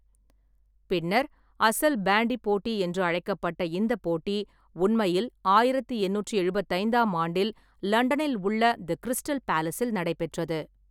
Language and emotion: Tamil, neutral